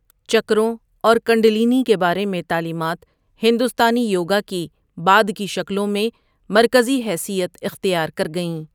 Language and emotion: Urdu, neutral